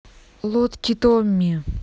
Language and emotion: Russian, neutral